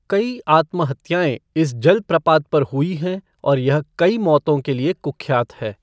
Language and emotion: Hindi, neutral